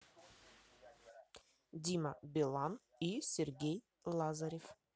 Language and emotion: Russian, neutral